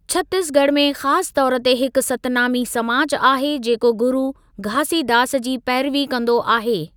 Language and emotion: Sindhi, neutral